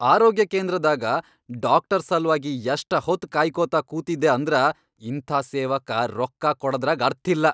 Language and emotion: Kannada, angry